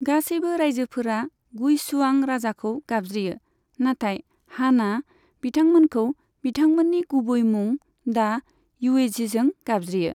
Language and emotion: Bodo, neutral